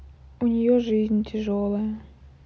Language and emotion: Russian, sad